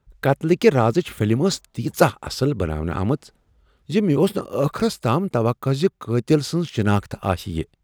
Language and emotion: Kashmiri, surprised